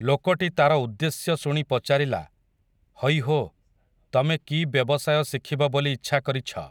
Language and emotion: Odia, neutral